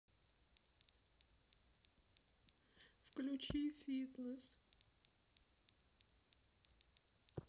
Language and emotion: Russian, sad